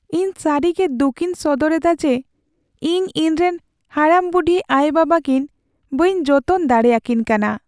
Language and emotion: Santali, sad